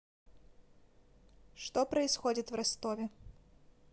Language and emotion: Russian, neutral